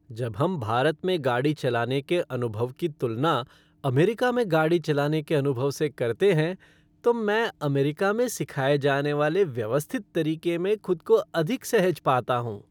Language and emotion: Hindi, happy